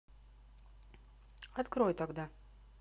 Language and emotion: Russian, neutral